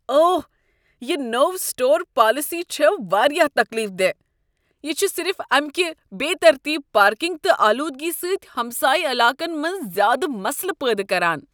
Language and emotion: Kashmiri, disgusted